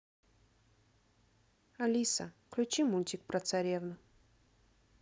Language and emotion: Russian, neutral